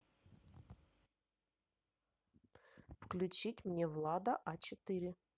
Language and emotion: Russian, neutral